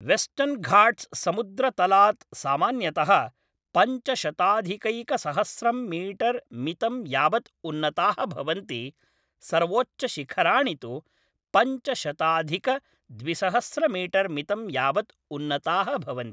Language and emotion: Sanskrit, neutral